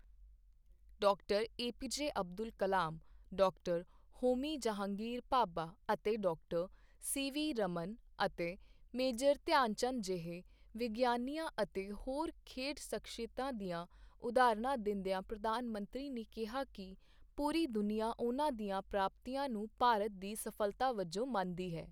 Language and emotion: Punjabi, neutral